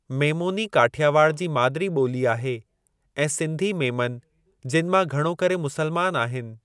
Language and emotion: Sindhi, neutral